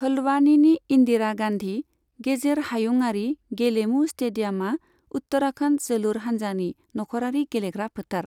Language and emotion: Bodo, neutral